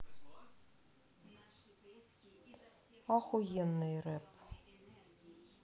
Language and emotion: Russian, angry